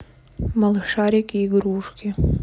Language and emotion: Russian, neutral